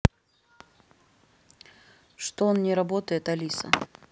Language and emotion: Russian, neutral